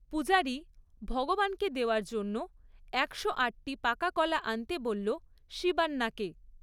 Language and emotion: Bengali, neutral